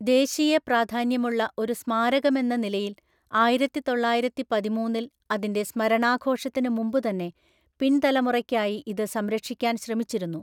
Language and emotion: Malayalam, neutral